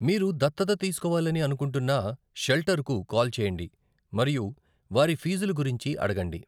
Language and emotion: Telugu, neutral